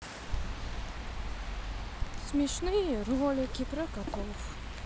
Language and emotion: Russian, neutral